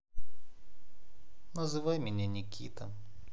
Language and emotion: Russian, neutral